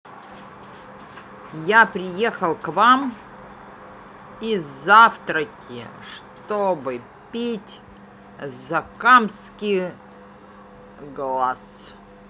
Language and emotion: Russian, angry